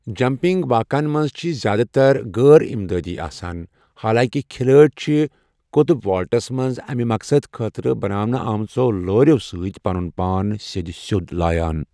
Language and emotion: Kashmiri, neutral